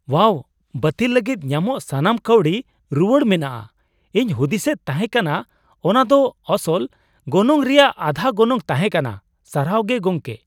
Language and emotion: Santali, surprised